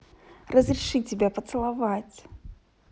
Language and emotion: Russian, positive